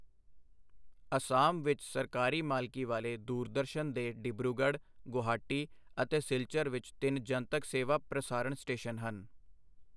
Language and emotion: Punjabi, neutral